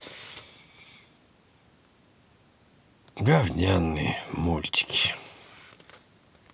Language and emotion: Russian, sad